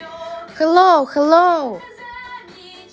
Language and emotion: Russian, positive